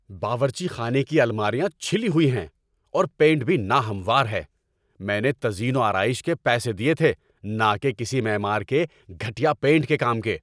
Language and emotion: Urdu, angry